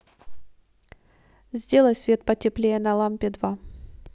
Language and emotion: Russian, neutral